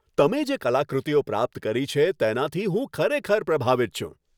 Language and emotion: Gujarati, happy